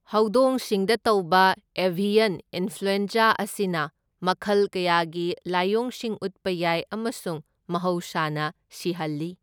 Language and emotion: Manipuri, neutral